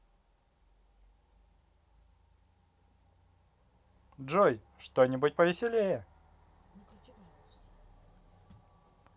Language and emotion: Russian, positive